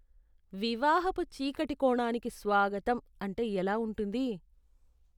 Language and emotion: Telugu, disgusted